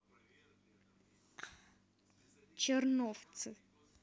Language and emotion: Russian, neutral